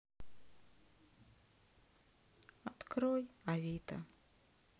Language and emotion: Russian, sad